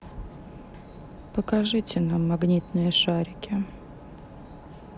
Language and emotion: Russian, sad